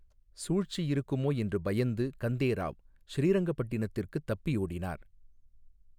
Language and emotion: Tamil, neutral